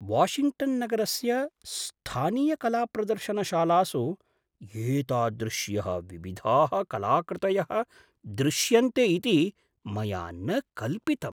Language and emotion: Sanskrit, surprised